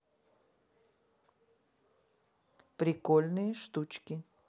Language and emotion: Russian, neutral